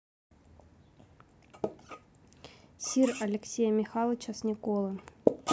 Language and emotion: Russian, neutral